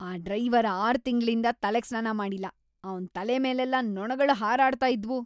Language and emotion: Kannada, disgusted